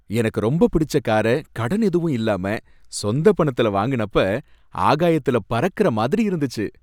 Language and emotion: Tamil, happy